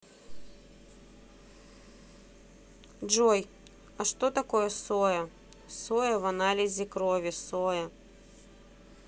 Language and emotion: Russian, neutral